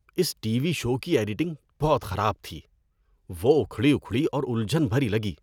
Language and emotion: Urdu, disgusted